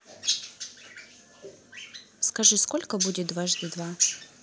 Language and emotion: Russian, neutral